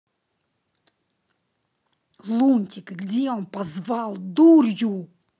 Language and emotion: Russian, angry